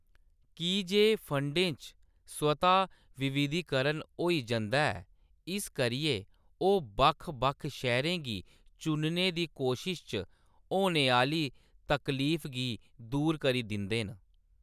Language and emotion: Dogri, neutral